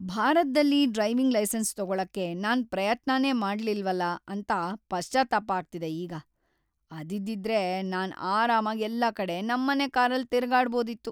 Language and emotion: Kannada, sad